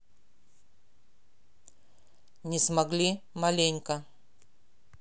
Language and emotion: Russian, neutral